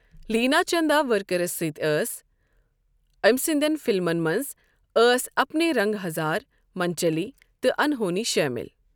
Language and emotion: Kashmiri, neutral